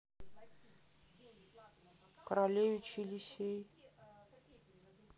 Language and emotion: Russian, sad